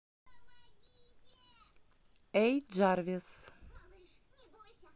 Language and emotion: Russian, neutral